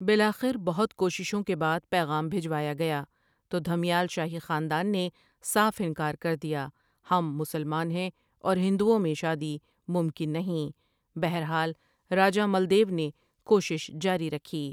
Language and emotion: Urdu, neutral